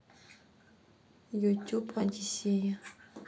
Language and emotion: Russian, neutral